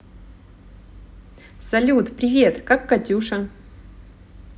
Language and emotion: Russian, positive